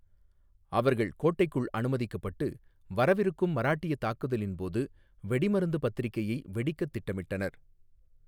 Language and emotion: Tamil, neutral